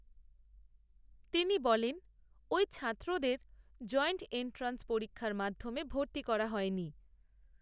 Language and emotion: Bengali, neutral